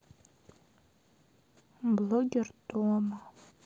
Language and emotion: Russian, sad